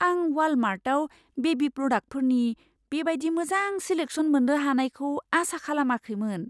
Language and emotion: Bodo, surprised